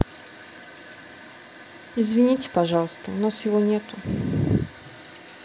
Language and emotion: Russian, sad